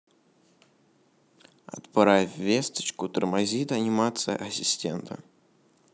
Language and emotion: Russian, neutral